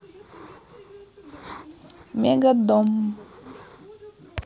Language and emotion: Russian, neutral